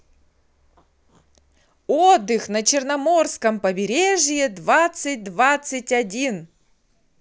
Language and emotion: Russian, positive